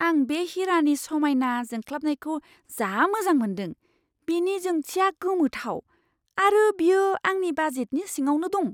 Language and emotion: Bodo, surprised